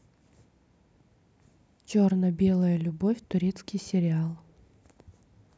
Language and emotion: Russian, neutral